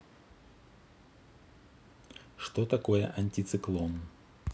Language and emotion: Russian, neutral